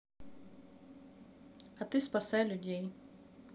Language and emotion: Russian, neutral